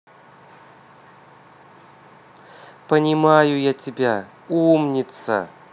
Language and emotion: Russian, positive